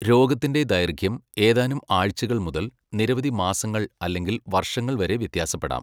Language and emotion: Malayalam, neutral